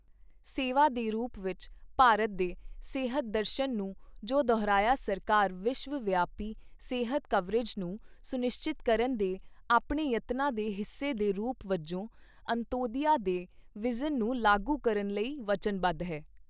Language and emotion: Punjabi, neutral